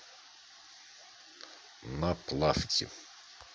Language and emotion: Russian, neutral